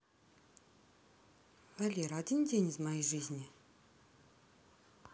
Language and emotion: Russian, neutral